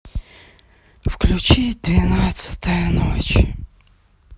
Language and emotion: Russian, sad